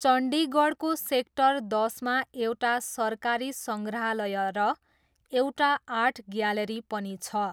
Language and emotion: Nepali, neutral